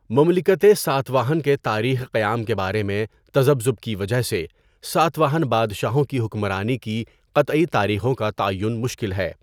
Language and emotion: Urdu, neutral